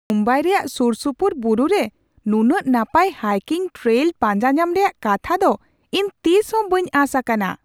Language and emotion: Santali, surprised